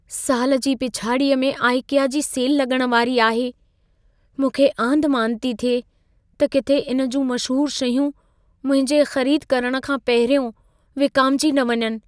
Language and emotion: Sindhi, fearful